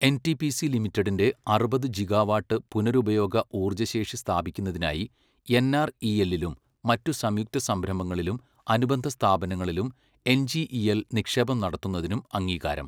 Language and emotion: Malayalam, neutral